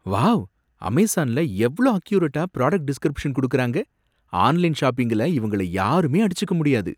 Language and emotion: Tamil, surprised